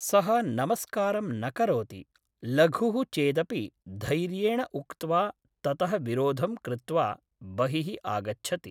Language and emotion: Sanskrit, neutral